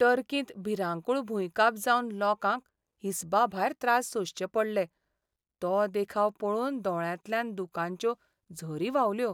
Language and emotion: Goan Konkani, sad